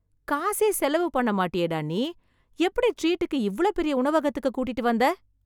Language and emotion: Tamil, surprised